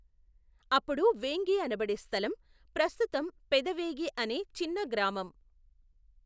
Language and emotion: Telugu, neutral